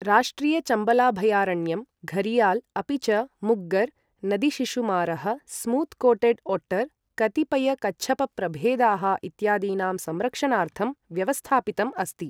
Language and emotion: Sanskrit, neutral